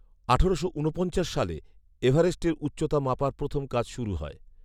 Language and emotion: Bengali, neutral